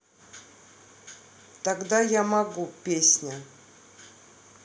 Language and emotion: Russian, neutral